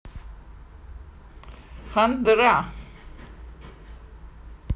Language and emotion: Russian, positive